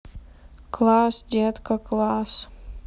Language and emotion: Russian, sad